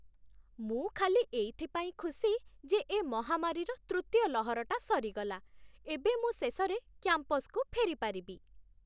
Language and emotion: Odia, happy